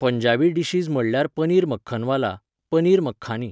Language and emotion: Goan Konkani, neutral